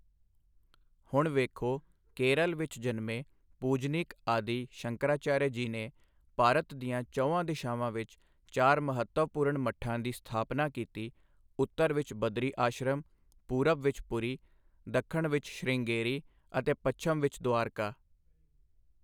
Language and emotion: Punjabi, neutral